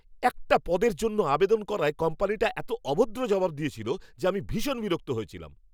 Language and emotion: Bengali, angry